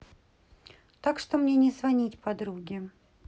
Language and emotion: Russian, neutral